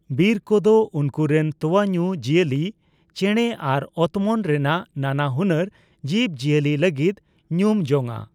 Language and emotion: Santali, neutral